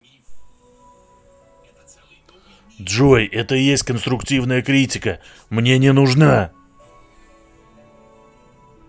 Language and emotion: Russian, angry